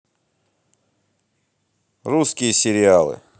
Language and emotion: Russian, neutral